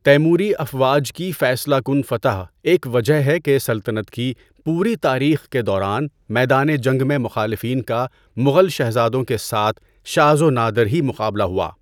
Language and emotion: Urdu, neutral